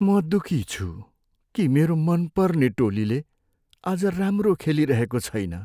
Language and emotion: Nepali, sad